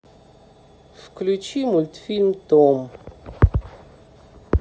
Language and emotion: Russian, neutral